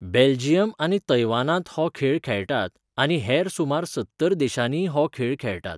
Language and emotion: Goan Konkani, neutral